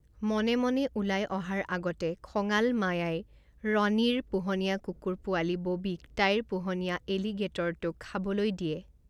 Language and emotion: Assamese, neutral